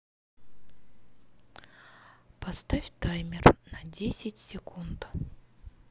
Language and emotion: Russian, neutral